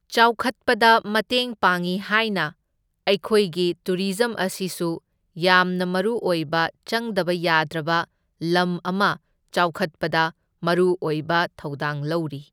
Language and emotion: Manipuri, neutral